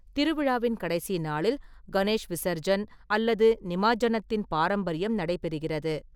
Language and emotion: Tamil, neutral